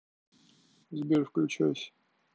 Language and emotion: Russian, neutral